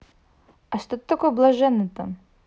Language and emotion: Russian, neutral